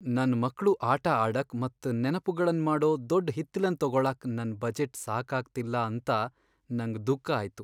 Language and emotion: Kannada, sad